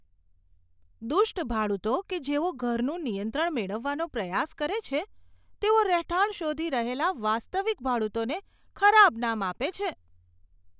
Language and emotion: Gujarati, disgusted